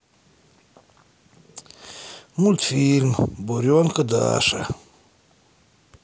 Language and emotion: Russian, sad